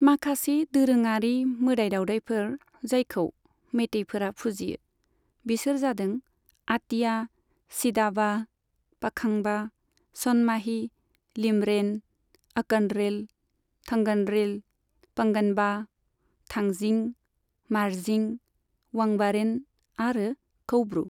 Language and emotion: Bodo, neutral